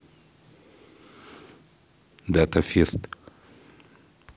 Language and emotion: Russian, neutral